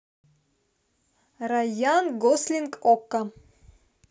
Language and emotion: Russian, neutral